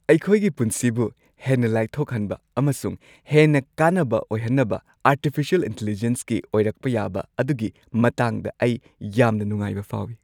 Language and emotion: Manipuri, happy